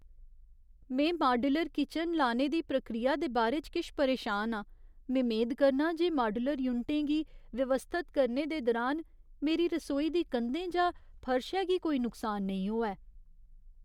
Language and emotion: Dogri, fearful